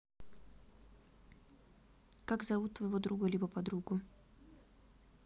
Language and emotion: Russian, neutral